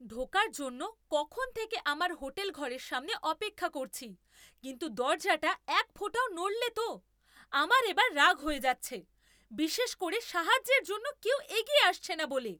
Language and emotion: Bengali, angry